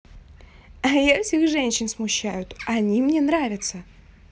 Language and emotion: Russian, positive